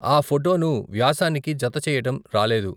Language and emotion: Telugu, neutral